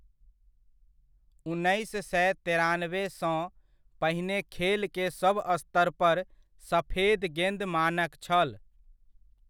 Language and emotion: Maithili, neutral